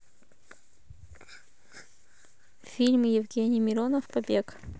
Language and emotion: Russian, neutral